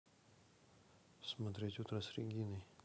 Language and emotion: Russian, neutral